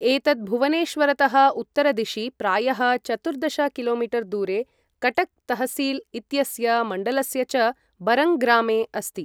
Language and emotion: Sanskrit, neutral